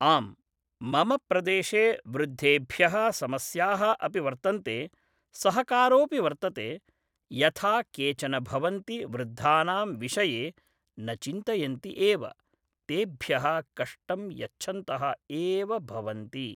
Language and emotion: Sanskrit, neutral